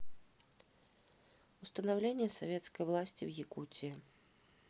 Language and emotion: Russian, neutral